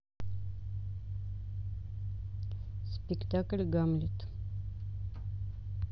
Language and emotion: Russian, neutral